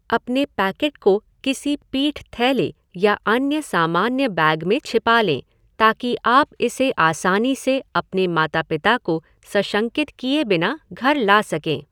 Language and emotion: Hindi, neutral